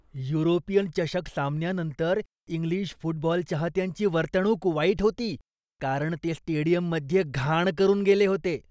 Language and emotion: Marathi, disgusted